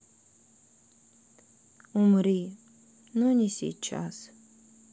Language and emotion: Russian, sad